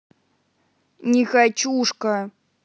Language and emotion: Russian, angry